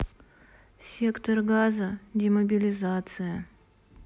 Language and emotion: Russian, sad